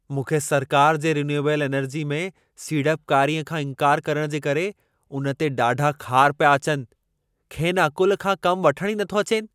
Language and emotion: Sindhi, angry